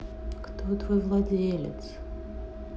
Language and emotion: Russian, sad